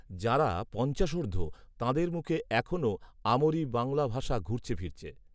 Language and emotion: Bengali, neutral